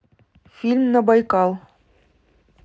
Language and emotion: Russian, neutral